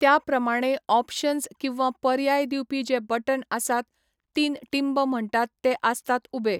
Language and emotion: Goan Konkani, neutral